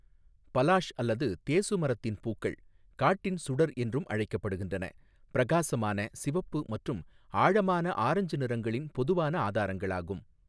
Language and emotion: Tamil, neutral